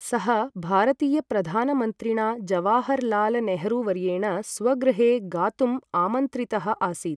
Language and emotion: Sanskrit, neutral